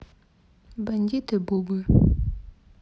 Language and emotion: Russian, neutral